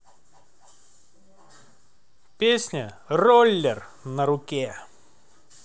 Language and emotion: Russian, positive